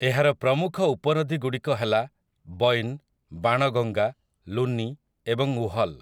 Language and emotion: Odia, neutral